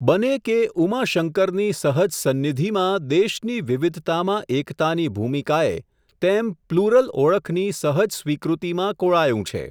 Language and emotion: Gujarati, neutral